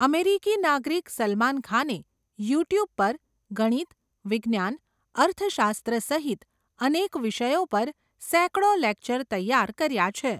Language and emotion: Gujarati, neutral